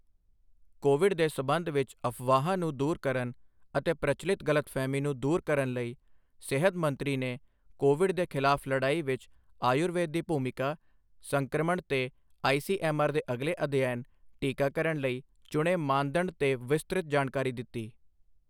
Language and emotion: Punjabi, neutral